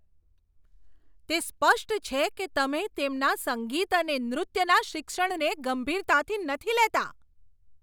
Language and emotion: Gujarati, angry